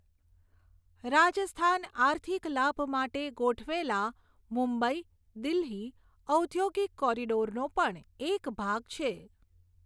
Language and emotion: Gujarati, neutral